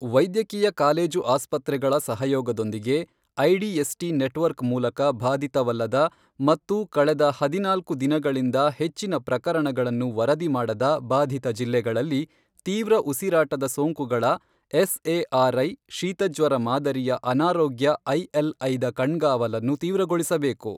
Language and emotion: Kannada, neutral